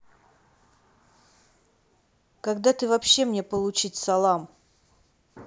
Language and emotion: Russian, angry